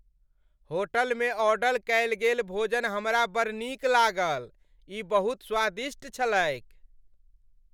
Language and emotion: Maithili, happy